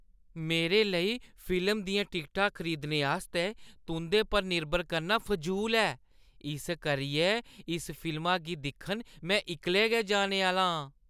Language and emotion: Dogri, disgusted